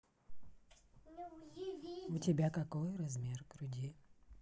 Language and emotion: Russian, neutral